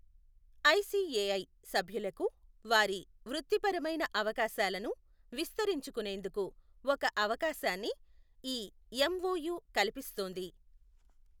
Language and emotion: Telugu, neutral